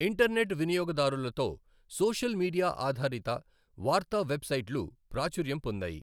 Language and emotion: Telugu, neutral